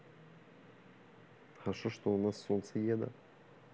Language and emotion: Russian, neutral